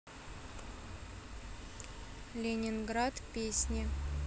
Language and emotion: Russian, neutral